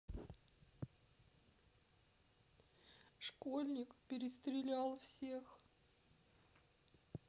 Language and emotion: Russian, sad